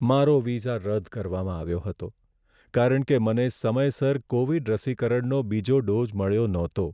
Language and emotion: Gujarati, sad